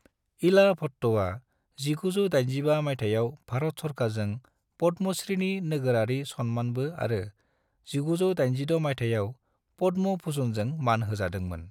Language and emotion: Bodo, neutral